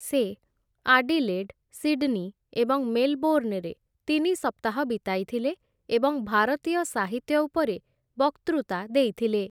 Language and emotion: Odia, neutral